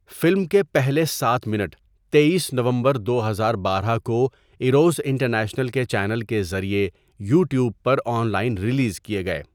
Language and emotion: Urdu, neutral